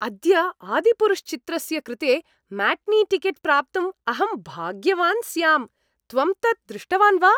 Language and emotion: Sanskrit, happy